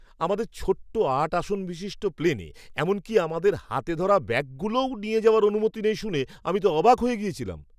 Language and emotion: Bengali, surprised